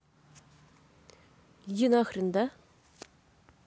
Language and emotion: Russian, neutral